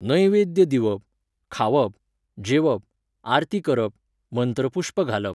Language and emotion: Goan Konkani, neutral